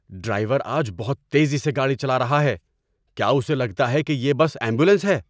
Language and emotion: Urdu, angry